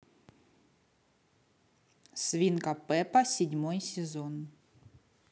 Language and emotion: Russian, neutral